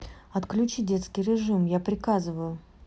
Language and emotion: Russian, neutral